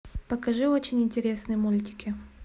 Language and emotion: Russian, neutral